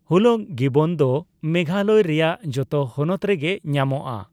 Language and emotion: Santali, neutral